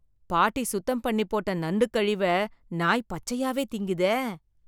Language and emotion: Tamil, disgusted